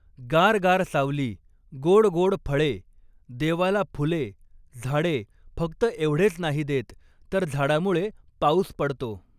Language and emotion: Marathi, neutral